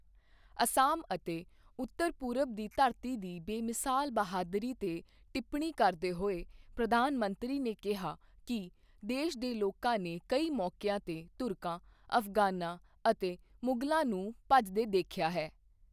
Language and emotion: Punjabi, neutral